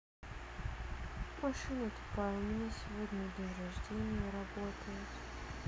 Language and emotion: Russian, sad